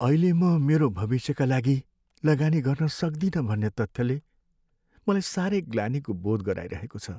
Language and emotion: Nepali, sad